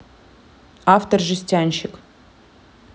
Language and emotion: Russian, neutral